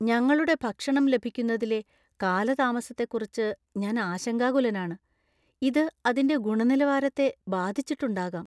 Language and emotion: Malayalam, fearful